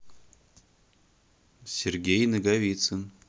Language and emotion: Russian, neutral